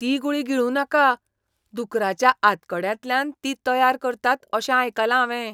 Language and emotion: Goan Konkani, disgusted